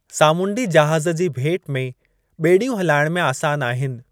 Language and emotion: Sindhi, neutral